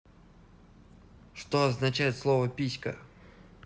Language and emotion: Russian, neutral